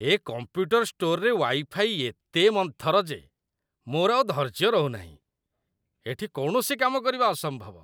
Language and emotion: Odia, disgusted